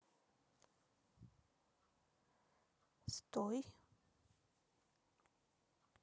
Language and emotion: Russian, neutral